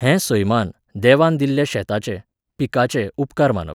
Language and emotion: Goan Konkani, neutral